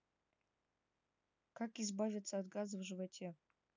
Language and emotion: Russian, neutral